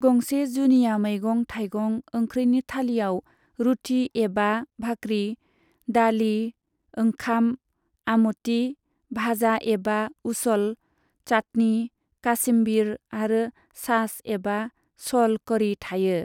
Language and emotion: Bodo, neutral